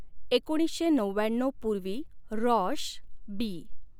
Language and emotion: Marathi, neutral